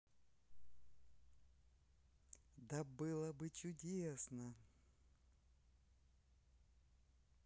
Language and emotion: Russian, positive